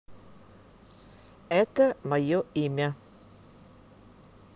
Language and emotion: Russian, neutral